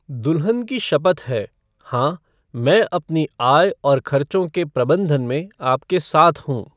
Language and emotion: Hindi, neutral